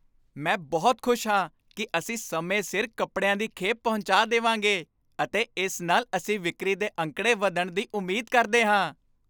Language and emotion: Punjabi, happy